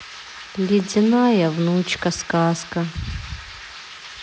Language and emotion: Russian, sad